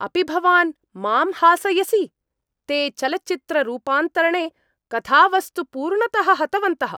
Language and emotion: Sanskrit, angry